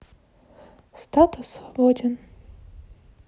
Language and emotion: Russian, neutral